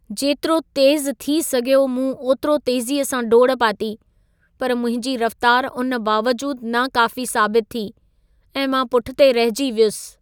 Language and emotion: Sindhi, sad